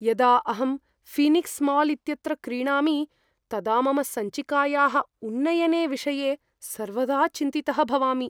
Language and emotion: Sanskrit, fearful